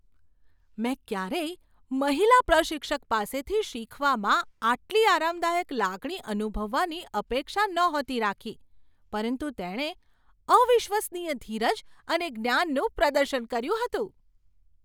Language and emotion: Gujarati, surprised